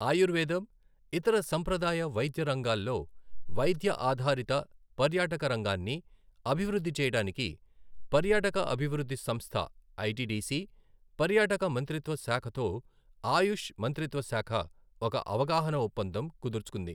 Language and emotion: Telugu, neutral